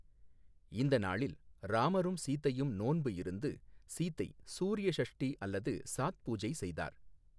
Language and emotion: Tamil, neutral